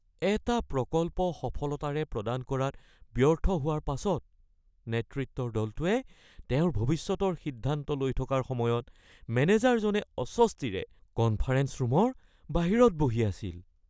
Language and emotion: Assamese, fearful